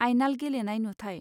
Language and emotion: Bodo, neutral